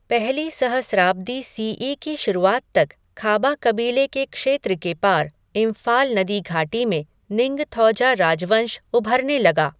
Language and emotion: Hindi, neutral